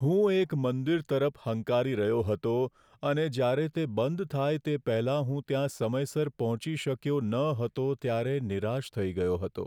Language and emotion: Gujarati, sad